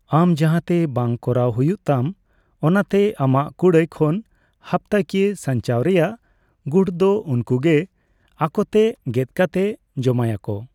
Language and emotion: Santali, neutral